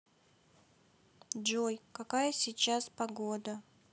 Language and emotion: Russian, sad